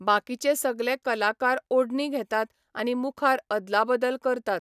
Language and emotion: Goan Konkani, neutral